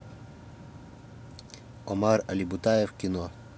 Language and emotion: Russian, neutral